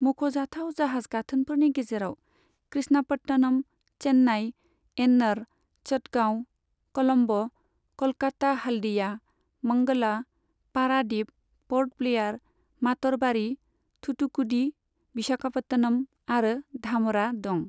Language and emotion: Bodo, neutral